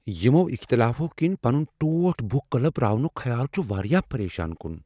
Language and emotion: Kashmiri, fearful